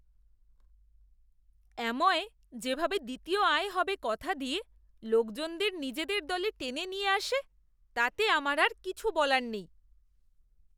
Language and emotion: Bengali, disgusted